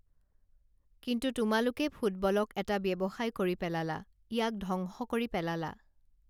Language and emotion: Assamese, neutral